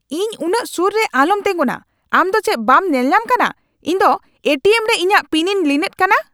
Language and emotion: Santali, angry